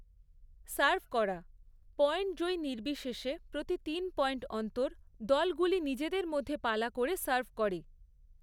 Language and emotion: Bengali, neutral